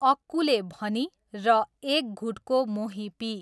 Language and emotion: Nepali, neutral